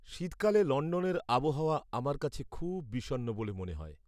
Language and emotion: Bengali, sad